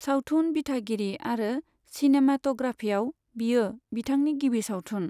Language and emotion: Bodo, neutral